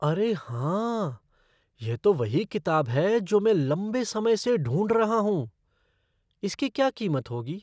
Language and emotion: Hindi, surprised